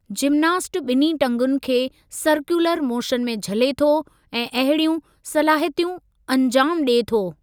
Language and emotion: Sindhi, neutral